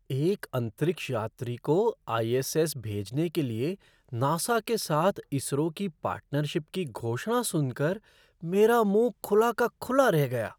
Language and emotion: Hindi, surprised